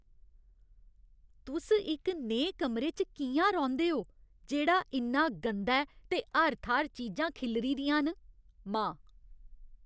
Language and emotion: Dogri, disgusted